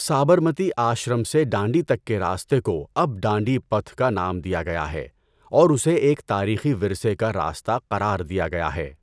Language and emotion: Urdu, neutral